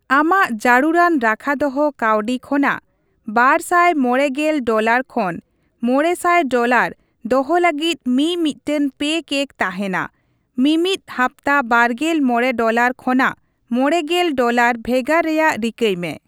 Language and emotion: Santali, neutral